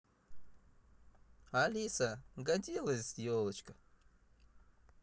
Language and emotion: Russian, positive